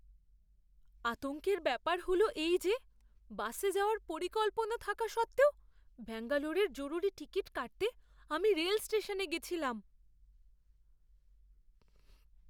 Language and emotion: Bengali, fearful